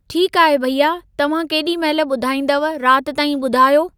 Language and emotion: Sindhi, neutral